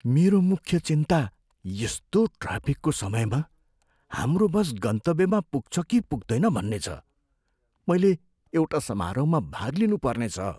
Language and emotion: Nepali, fearful